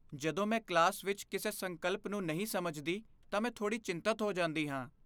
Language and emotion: Punjabi, fearful